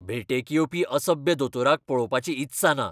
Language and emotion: Goan Konkani, angry